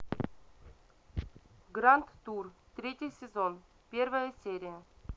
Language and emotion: Russian, neutral